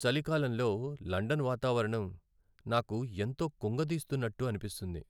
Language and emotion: Telugu, sad